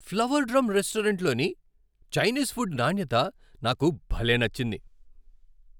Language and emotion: Telugu, happy